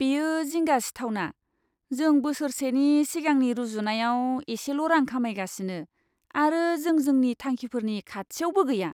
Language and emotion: Bodo, disgusted